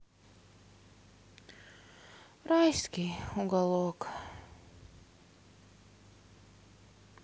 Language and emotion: Russian, sad